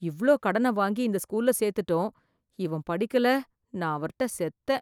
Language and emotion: Tamil, fearful